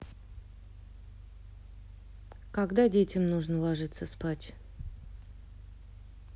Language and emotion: Russian, neutral